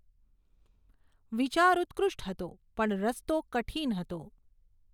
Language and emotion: Gujarati, neutral